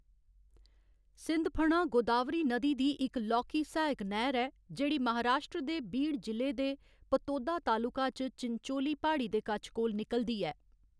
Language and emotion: Dogri, neutral